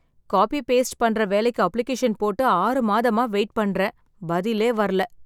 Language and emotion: Tamil, sad